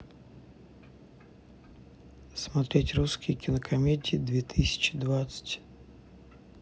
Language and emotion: Russian, neutral